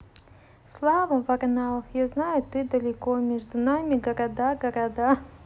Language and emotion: Russian, positive